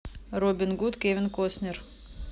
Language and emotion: Russian, neutral